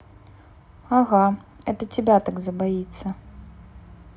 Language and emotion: Russian, neutral